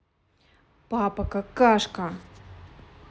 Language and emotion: Russian, angry